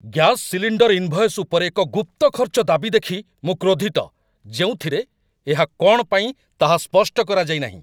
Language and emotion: Odia, angry